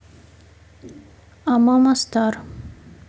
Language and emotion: Russian, neutral